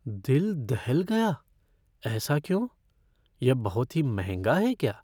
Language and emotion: Hindi, fearful